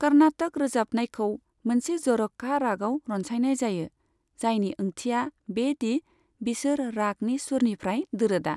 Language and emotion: Bodo, neutral